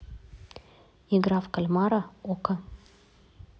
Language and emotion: Russian, neutral